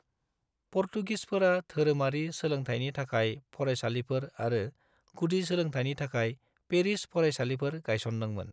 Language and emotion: Bodo, neutral